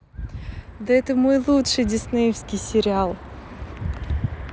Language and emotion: Russian, positive